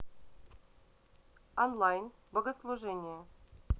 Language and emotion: Russian, neutral